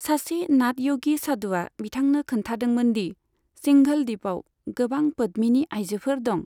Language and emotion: Bodo, neutral